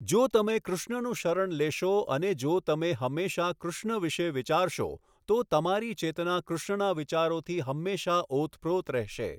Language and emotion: Gujarati, neutral